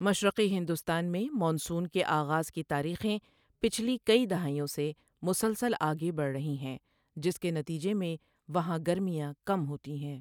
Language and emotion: Urdu, neutral